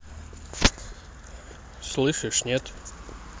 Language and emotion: Russian, neutral